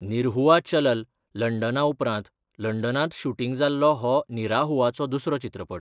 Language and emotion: Goan Konkani, neutral